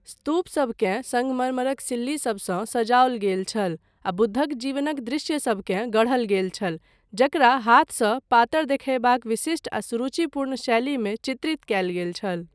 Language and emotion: Maithili, neutral